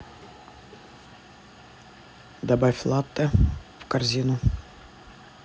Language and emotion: Russian, neutral